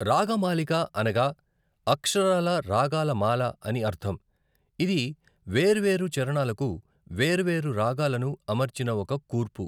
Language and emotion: Telugu, neutral